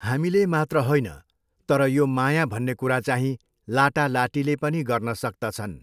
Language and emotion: Nepali, neutral